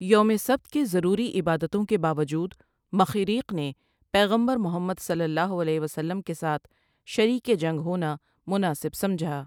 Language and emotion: Urdu, neutral